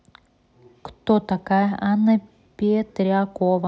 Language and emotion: Russian, neutral